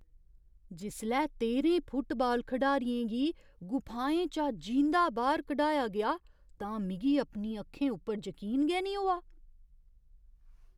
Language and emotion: Dogri, surprised